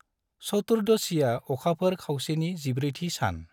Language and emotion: Bodo, neutral